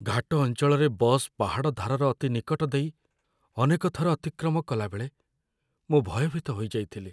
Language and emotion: Odia, fearful